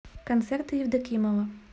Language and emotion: Russian, neutral